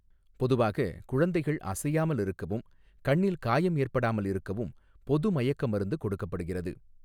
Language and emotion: Tamil, neutral